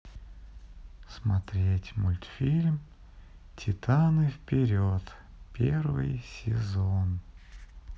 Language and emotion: Russian, sad